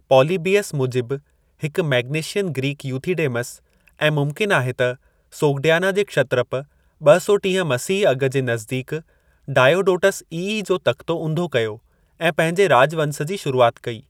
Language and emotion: Sindhi, neutral